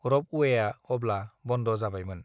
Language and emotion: Bodo, neutral